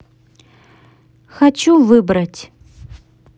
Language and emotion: Russian, neutral